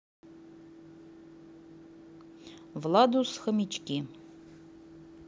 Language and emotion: Russian, neutral